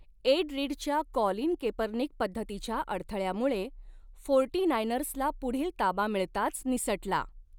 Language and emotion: Marathi, neutral